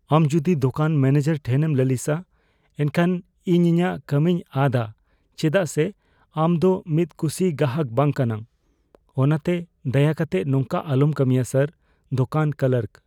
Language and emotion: Santali, fearful